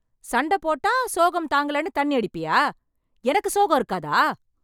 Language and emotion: Tamil, angry